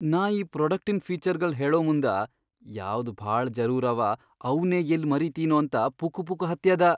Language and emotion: Kannada, fearful